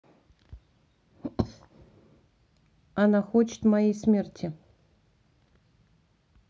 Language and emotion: Russian, neutral